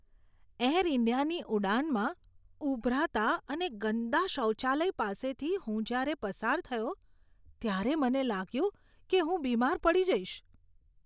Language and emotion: Gujarati, disgusted